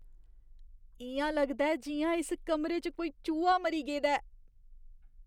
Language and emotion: Dogri, disgusted